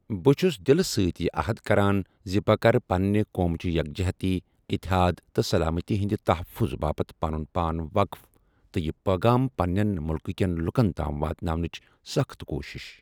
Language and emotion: Kashmiri, neutral